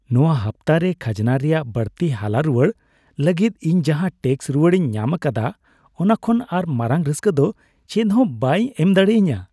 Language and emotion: Santali, happy